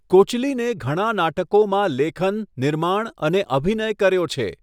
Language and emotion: Gujarati, neutral